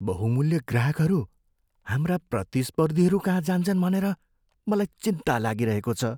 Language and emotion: Nepali, fearful